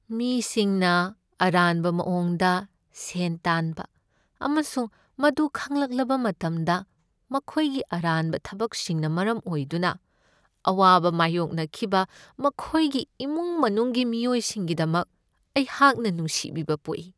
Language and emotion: Manipuri, sad